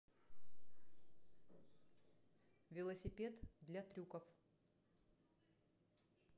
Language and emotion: Russian, neutral